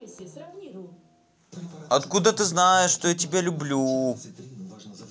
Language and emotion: Russian, neutral